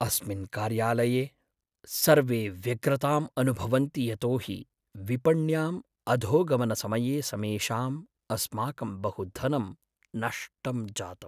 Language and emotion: Sanskrit, sad